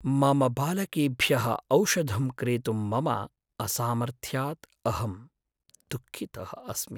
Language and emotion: Sanskrit, sad